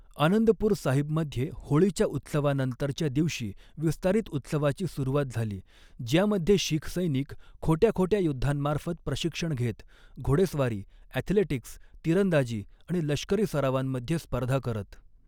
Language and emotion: Marathi, neutral